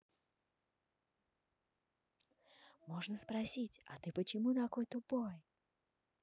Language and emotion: Russian, neutral